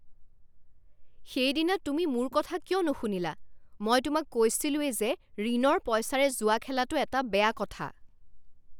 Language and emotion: Assamese, angry